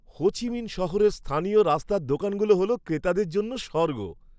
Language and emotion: Bengali, happy